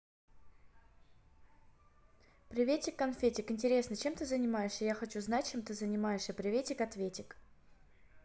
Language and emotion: Russian, neutral